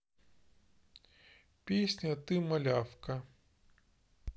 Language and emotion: Russian, neutral